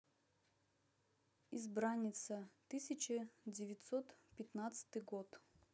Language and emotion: Russian, neutral